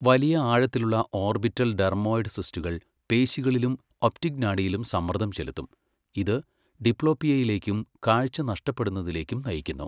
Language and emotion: Malayalam, neutral